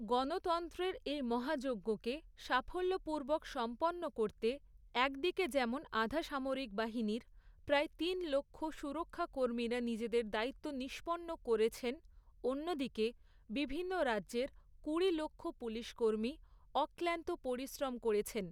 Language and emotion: Bengali, neutral